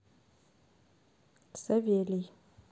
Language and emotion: Russian, neutral